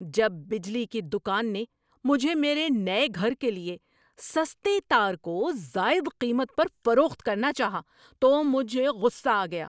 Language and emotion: Urdu, angry